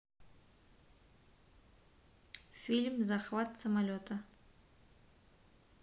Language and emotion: Russian, neutral